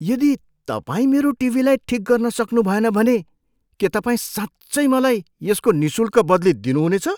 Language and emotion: Nepali, surprised